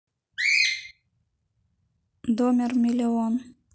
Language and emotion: Russian, neutral